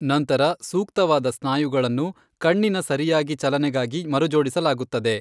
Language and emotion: Kannada, neutral